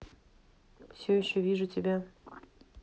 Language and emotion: Russian, neutral